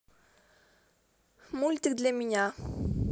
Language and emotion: Russian, neutral